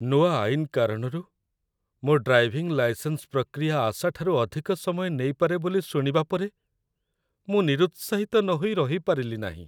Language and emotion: Odia, sad